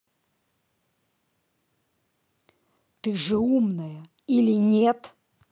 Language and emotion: Russian, angry